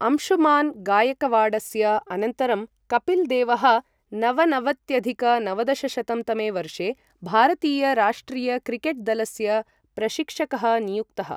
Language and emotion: Sanskrit, neutral